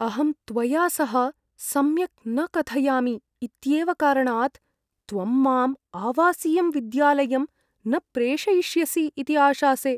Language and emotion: Sanskrit, fearful